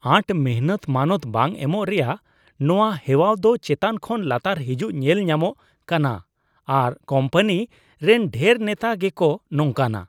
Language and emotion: Santali, disgusted